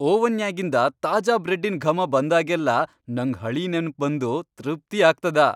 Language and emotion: Kannada, happy